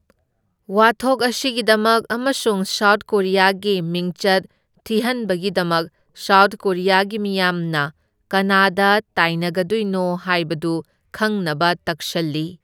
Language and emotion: Manipuri, neutral